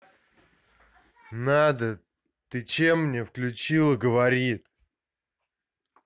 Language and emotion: Russian, angry